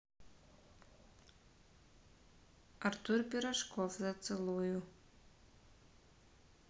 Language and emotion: Russian, neutral